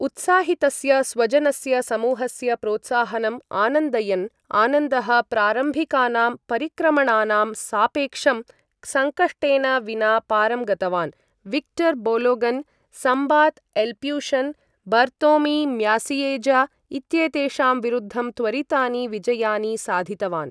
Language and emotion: Sanskrit, neutral